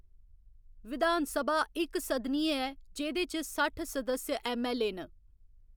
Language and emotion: Dogri, neutral